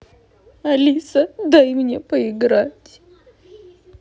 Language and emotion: Russian, sad